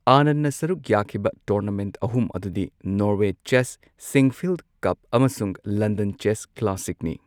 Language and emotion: Manipuri, neutral